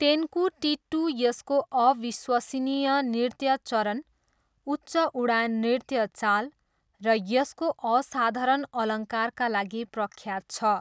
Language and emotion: Nepali, neutral